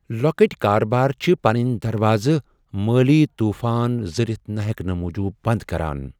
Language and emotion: Kashmiri, fearful